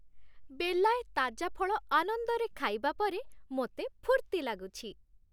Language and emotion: Odia, happy